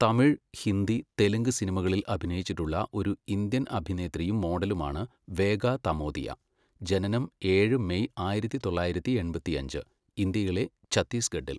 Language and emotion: Malayalam, neutral